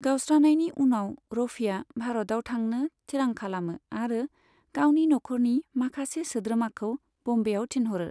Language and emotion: Bodo, neutral